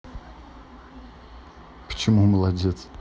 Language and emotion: Russian, neutral